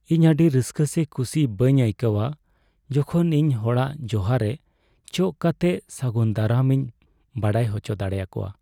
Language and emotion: Santali, sad